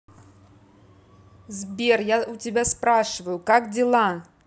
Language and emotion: Russian, angry